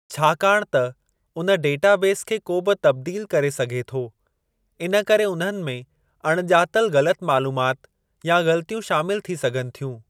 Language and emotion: Sindhi, neutral